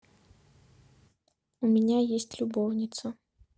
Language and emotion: Russian, neutral